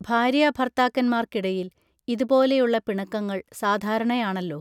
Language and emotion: Malayalam, neutral